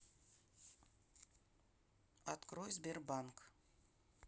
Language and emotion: Russian, neutral